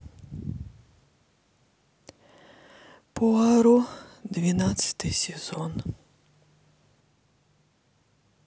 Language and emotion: Russian, sad